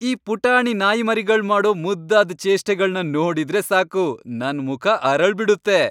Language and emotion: Kannada, happy